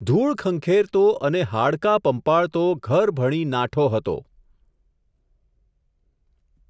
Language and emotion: Gujarati, neutral